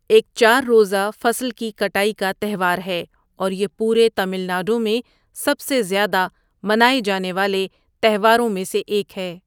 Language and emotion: Urdu, neutral